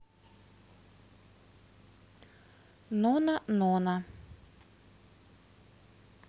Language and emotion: Russian, neutral